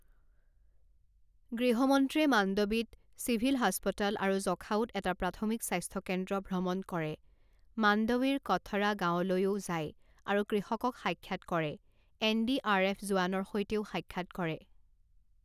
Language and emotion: Assamese, neutral